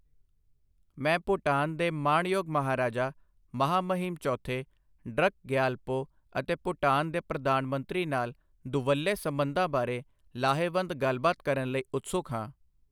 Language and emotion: Punjabi, neutral